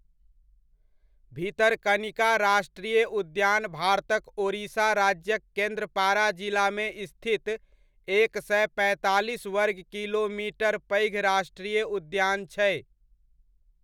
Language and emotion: Maithili, neutral